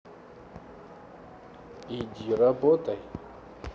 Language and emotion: Russian, neutral